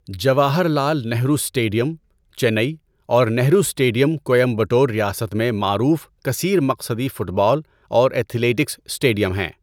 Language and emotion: Urdu, neutral